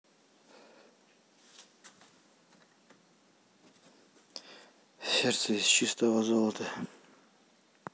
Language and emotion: Russian, neutral